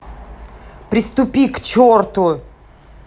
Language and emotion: Russian, angry